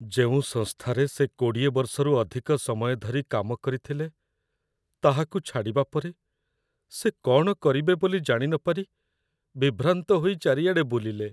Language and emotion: Odia, sad